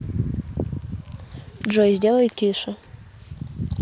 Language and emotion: Russian, neutral